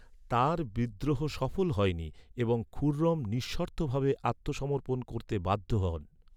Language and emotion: Bengali, neutral